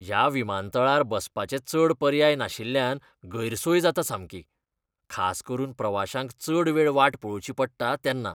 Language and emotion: Goan Konkani, disgusted